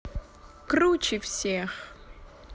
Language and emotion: Russian, positive